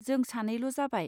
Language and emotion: Bodo, neutral